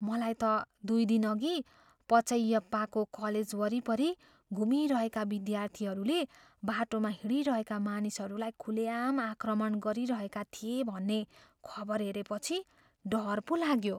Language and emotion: Nepali, fearful